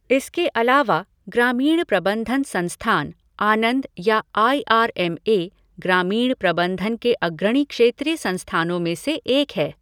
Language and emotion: Hindi, neutral